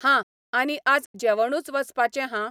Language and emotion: Goan Konkani, neutral